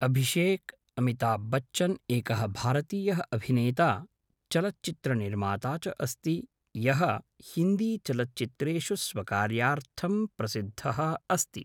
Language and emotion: Sanskrit, neutral